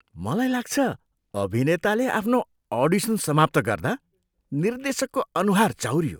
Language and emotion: Nepali, disgusted